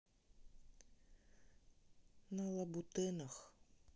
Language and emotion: Russian, sad